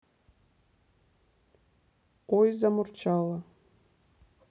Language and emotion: Russian, neutral